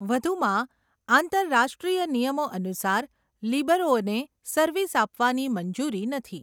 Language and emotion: Gujarati, neutral